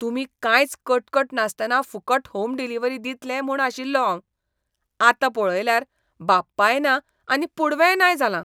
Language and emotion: Goan Konkani, disgusted